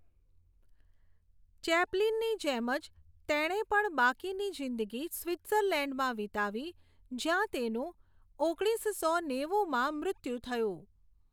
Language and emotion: Gujarati, neutral